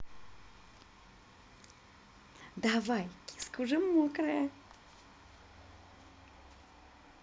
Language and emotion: Russian, positive